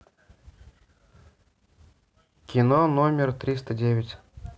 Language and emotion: Russian, neutral